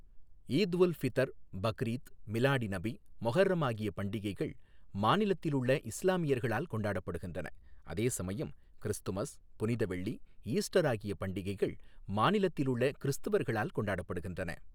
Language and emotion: Tamil, neutral